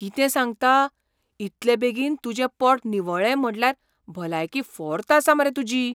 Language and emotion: Goan Konkani, surprised